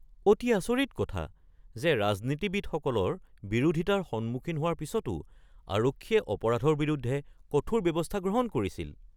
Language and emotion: Assamese, surprised